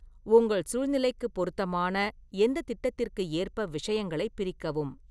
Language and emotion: Tamil, neutral